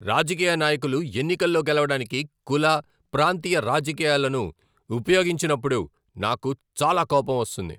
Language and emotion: Telugu, angry